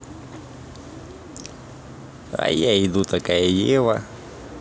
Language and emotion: Russian, positive